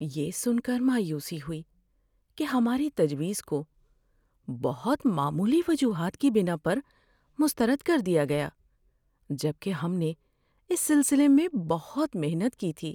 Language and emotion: Urdu, sad